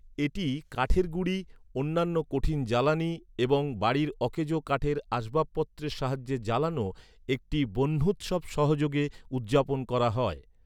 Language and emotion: Bengali, neutral